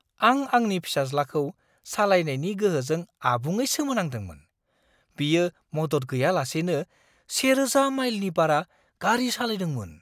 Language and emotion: Bodo, surprised